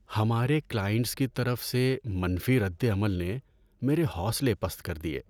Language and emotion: Urdu, sad